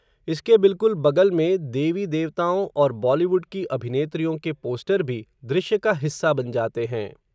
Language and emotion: Hindi, neutral